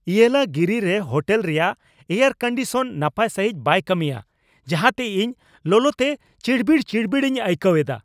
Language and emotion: Santali, angry